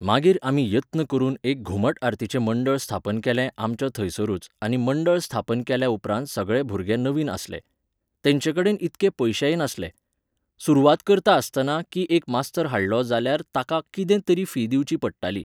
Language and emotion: Goan Konkani, neutral